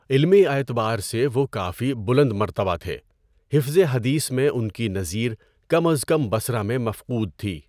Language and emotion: Urdu, neutral